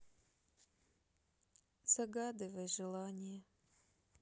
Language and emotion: Russian, sad